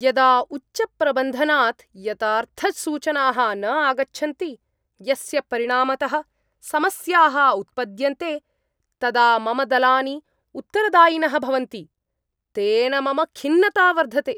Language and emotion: Sanskrit, angry